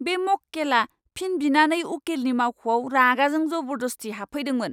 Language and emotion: Bodo, angry